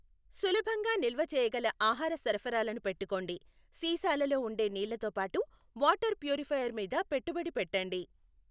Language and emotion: Telugu, neutral